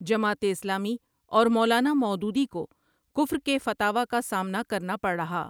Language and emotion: Urdu, neutral